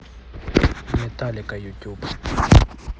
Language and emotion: Russian, neutral